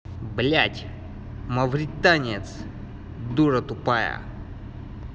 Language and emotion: Russian, angry